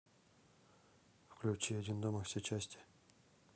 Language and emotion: Russian, neutral